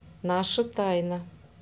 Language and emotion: Russian, neutral